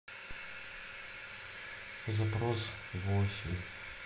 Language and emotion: Russian, sad